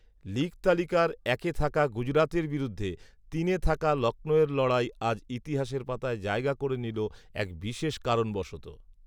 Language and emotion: Bengali, neutral